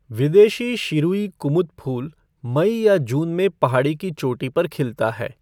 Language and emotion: Hindi, neutral